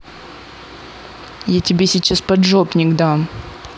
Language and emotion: Russian, angry